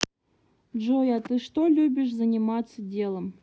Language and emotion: Russian, neutral